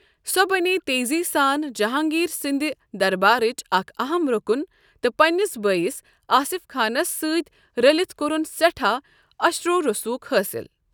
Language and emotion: Kashmiri, neutral